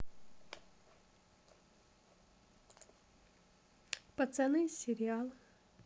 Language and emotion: Russian, neutral